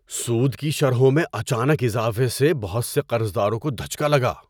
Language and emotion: Urdu, surprised